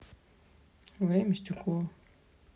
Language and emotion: Russian, neutral